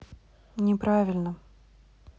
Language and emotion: Russian, neutral